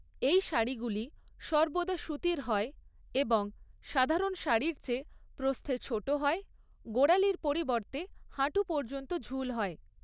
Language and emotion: Bengali, neutral